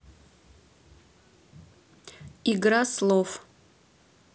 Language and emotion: Russian, neutral